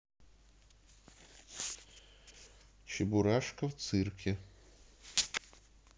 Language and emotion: Russian, neutral